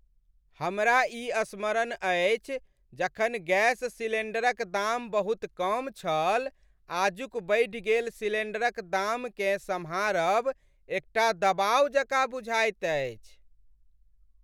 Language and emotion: Maithili, sad